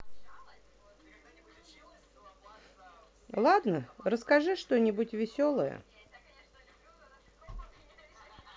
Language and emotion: Russian, neutral